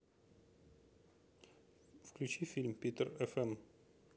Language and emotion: Russian, neutral